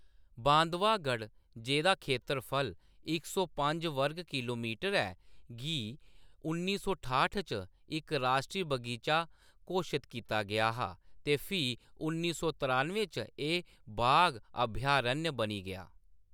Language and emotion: Dogri, neutral